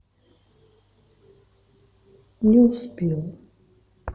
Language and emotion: Russian, sad